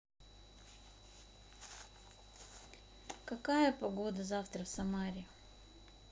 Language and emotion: Russian, neutral